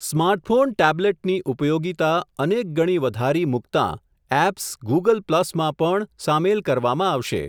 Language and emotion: Gujarati, neutral